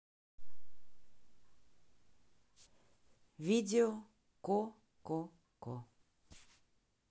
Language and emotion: Russian, neutral